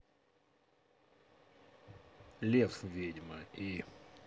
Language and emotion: Russian, neutral